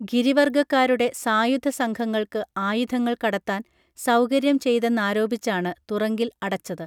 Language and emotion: Malayalam, neutral